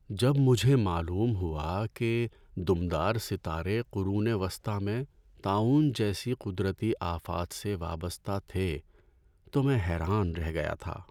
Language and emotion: Urdu, sad